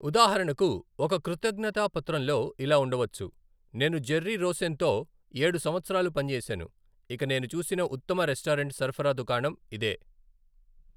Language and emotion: Telugu, neutral